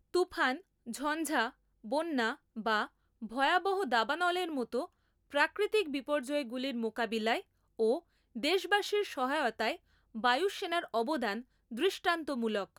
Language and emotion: Bengali, neutral